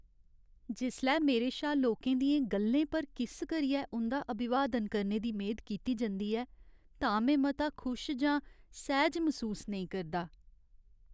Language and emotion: Dogri, sad